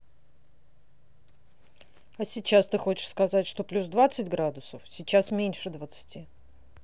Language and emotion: Russian, angry